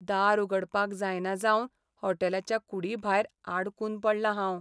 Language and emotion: Goan Konkani, sad